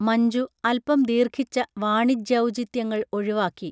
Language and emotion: Malayalam, neutral